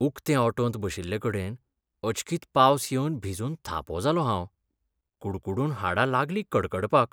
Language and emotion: Goan Konkani, sad